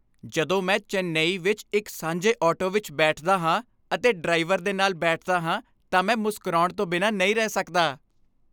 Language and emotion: Punjabi, happy